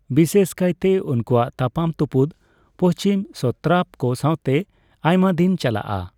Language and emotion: Santali, neutral